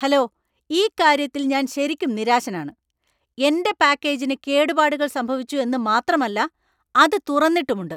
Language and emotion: Malayalam, angry